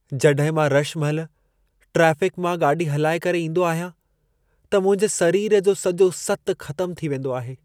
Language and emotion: Sindhi, sad